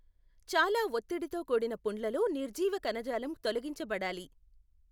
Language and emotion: Telugu, neutral